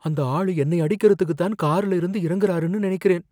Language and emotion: Tamil, fearful